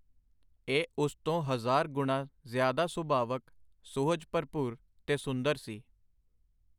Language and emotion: Punjabi, neutral